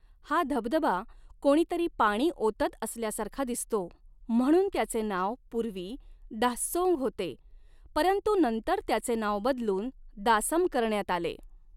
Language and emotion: Marathi, neutral